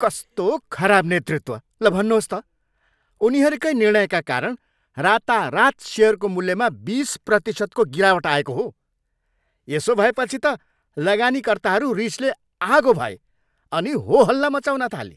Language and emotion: Nepali, angry